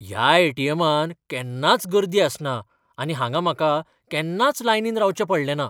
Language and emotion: Goan Konkani, surprised